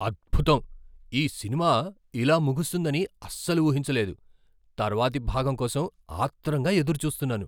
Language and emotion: Telugu, surprised